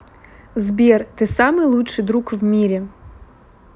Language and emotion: Russian, neutral